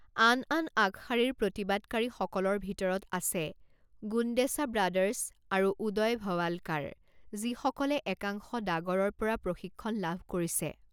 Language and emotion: Assamese, neutral